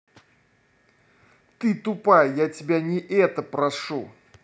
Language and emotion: Russian, angry